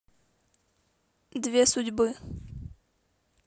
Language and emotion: Russian, neutral